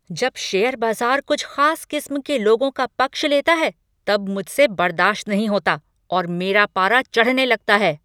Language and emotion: Hindi, angry